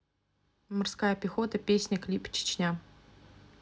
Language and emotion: Russian, neutral